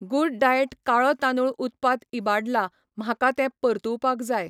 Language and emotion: Goan Konkani, neutral